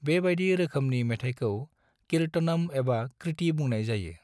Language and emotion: Bodo, neutral